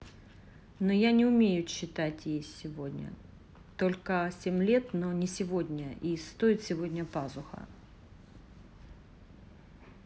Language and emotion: Russian, neutral